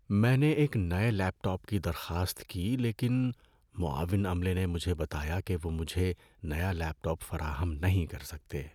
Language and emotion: Urdu, sad